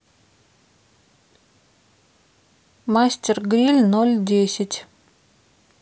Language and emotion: Russian, neutral